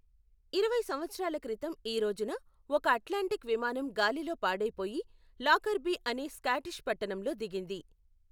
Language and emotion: Telugu, neutral